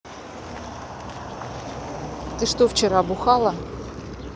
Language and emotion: Russian, neutral